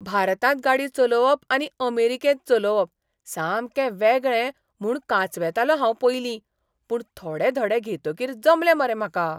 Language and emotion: Goan Konkani, surprised